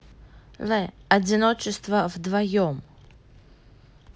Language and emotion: Russian, neutral